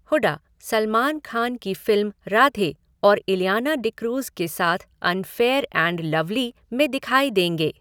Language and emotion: Hindi, neutral